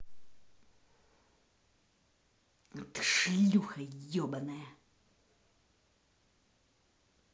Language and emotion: Russian, angry